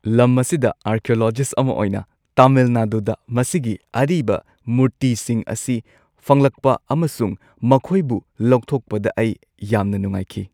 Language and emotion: Manipuri, happy